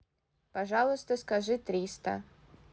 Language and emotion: Russian, neutral